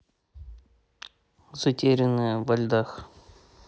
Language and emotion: Russian, neutral